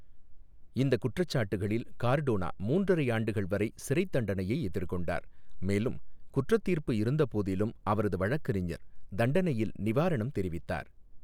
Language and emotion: Tamil, neutral